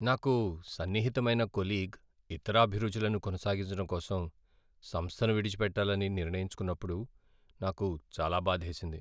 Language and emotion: Telugu, sad